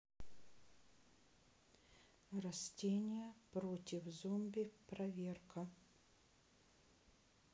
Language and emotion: Russian, neutral